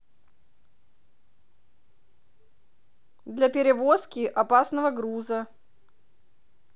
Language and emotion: Russian, neutral